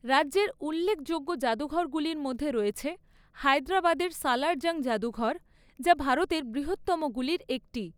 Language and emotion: Bengali, neutral